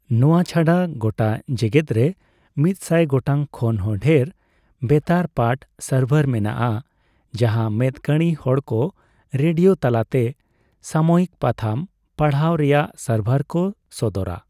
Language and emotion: Santali, neutral